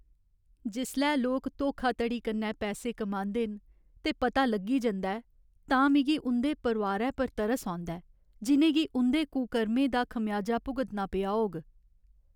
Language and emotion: Dogri, sad